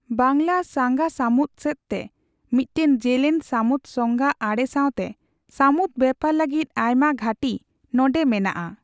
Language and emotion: Santali, neutral